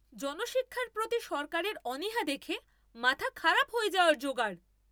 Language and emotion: Bengali, angry